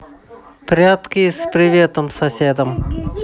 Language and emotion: Russian, neutral